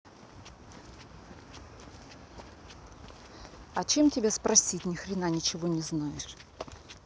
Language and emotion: Russian, angry